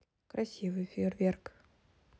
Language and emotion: Russian, neutral